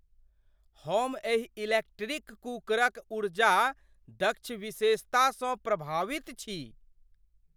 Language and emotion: Maithili, surprised